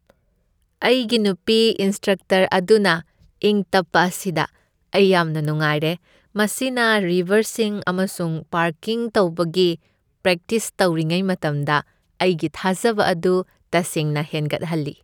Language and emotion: Manipuri, happy